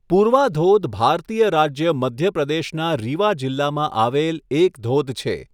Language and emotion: Gujarati, neutral